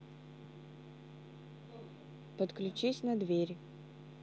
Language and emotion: Russian, neutral